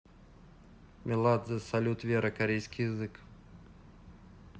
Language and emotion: Russian, neutral